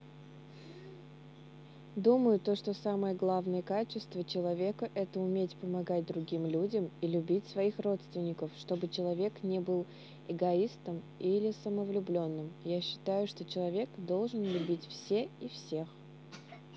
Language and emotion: Russian, neutral